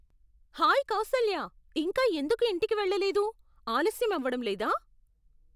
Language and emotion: Telugu, surprised